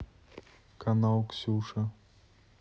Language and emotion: Russian, neutral